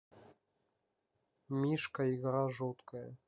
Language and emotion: Russian, neutral